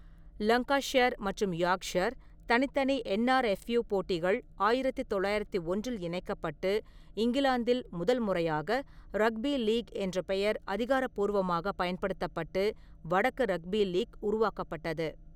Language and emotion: Tamil, neutral